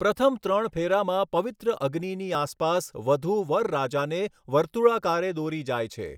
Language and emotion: Gujarati, neutral